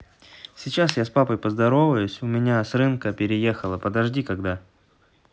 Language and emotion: Russian, neutral